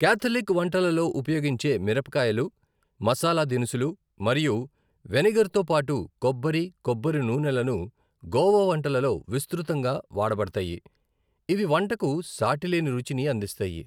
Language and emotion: Telugu, neutral